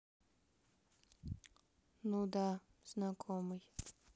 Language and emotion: Russian, sad